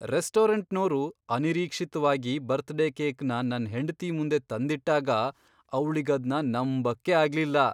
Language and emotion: Kannada, surprised